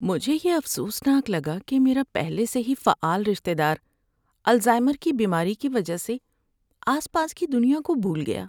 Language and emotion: Urdu, sad